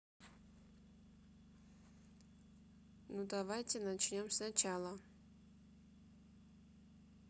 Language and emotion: Russian, neutral